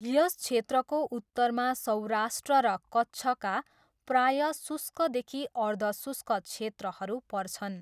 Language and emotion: Nepali, neutral